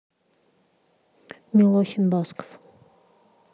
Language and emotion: Russian, neutral